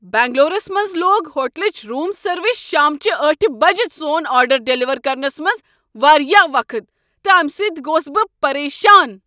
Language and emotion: Kashmiri, angry